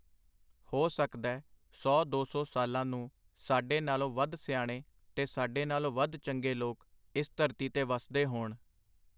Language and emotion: Punjabi, neutral